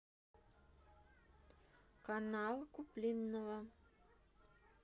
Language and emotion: Russian, neutral